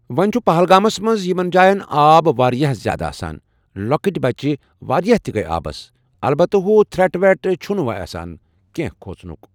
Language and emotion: Kashmiri, neutral